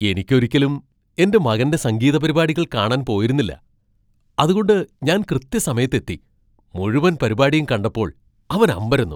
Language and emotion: Malayalam, surprised